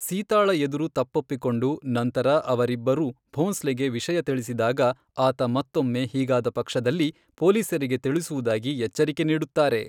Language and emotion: Kannada, neutral